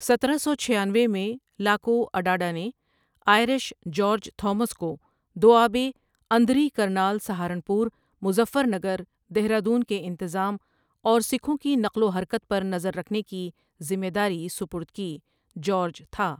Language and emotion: Urdu, neutral